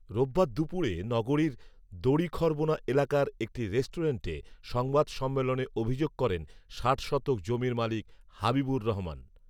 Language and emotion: Bengali, neutral